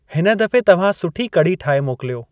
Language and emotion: Sindhi, neutral